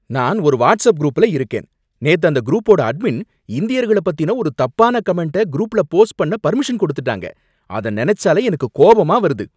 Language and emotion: Tamil, angry